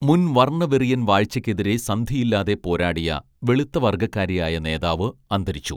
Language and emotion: Malayalam, neutral